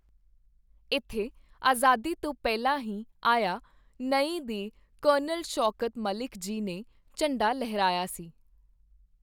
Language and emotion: Punjabi, neutral